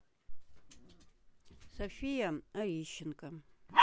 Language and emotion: Russian, neutral